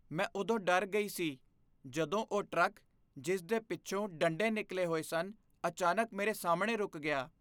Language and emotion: Punjabi, fearful